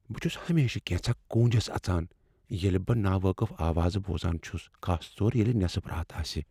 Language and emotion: Kashmiri, fearful